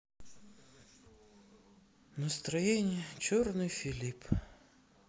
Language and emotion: Russian, sad